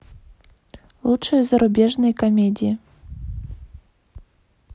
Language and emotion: Russian, neutral